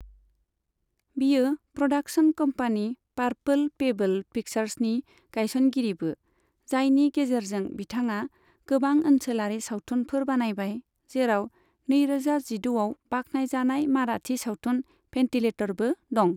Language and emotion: Bodo, neutral